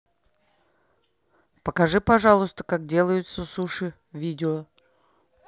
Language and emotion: Russian, neutral